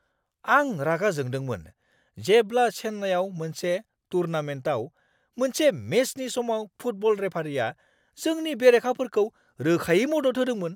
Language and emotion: Bodo, angry